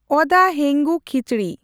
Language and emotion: Santali, neutral